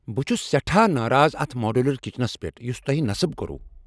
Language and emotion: Kashmiri, angry